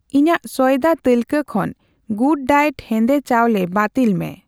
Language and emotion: Santali, neutral